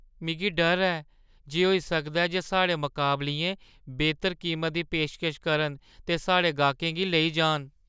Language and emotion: Dogri, fearful